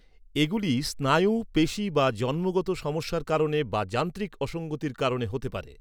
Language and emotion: Bengali, neutral